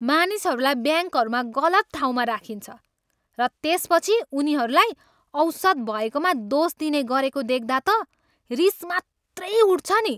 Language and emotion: Nepali, angry